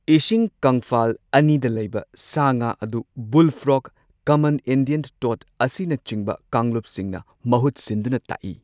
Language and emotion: Manipuri, neutral